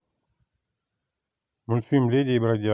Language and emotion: Russian, neutral